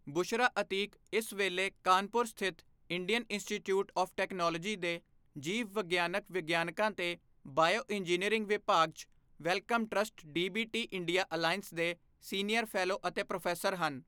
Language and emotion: Punjabi, neutral